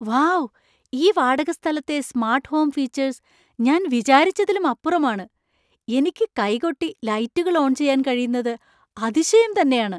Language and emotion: Malayalam, surprised